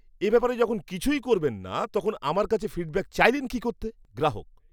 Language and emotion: Bengali, disgusted